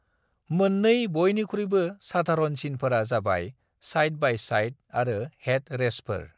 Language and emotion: Bodo, neutral